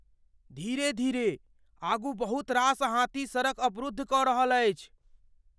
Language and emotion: Maithili, fearful